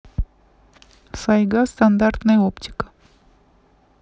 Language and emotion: Russian, neutral